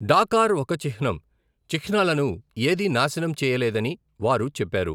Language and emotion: Telugu, neutral